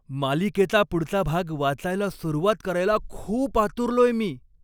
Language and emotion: Marathi, happy